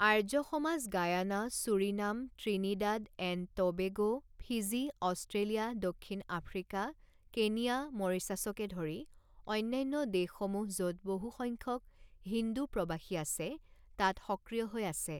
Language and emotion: Assamese, neutral